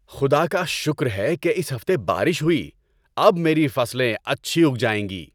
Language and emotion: Urdu, happy